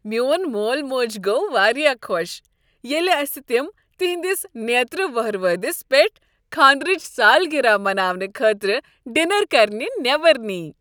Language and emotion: Kashmiri, happy